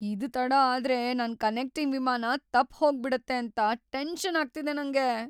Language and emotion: Kannada, fearful